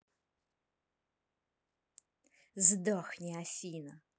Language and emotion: Russian, angry